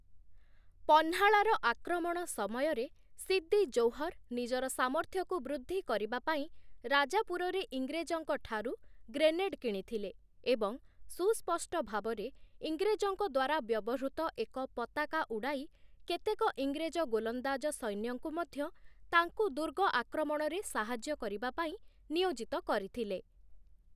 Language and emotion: Odia, neutral